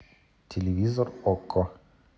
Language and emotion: Russian, neutral